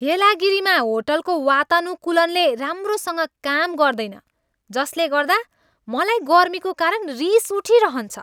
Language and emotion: Nepali, angry